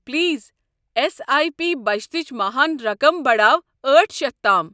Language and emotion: Kashmiri, neutral